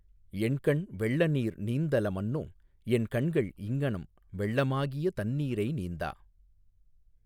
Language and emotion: Tamil, neutral